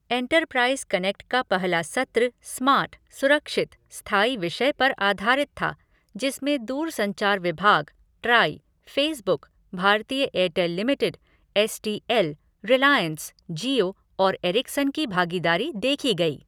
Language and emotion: Hindi, neutral